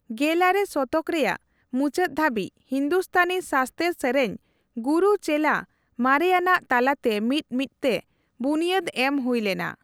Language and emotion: Santali, neutral